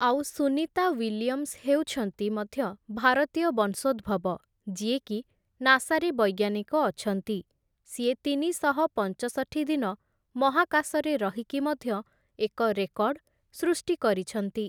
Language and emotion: Odia, neutral